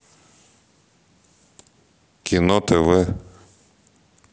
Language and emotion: Russian, neutral